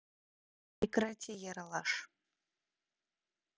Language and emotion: Russian, neutral